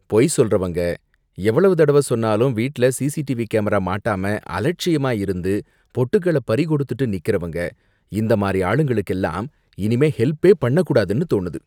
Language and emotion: Tamil, disgusted